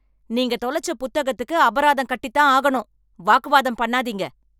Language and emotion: Tamil, angry